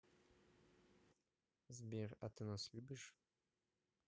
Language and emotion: Russian, neutral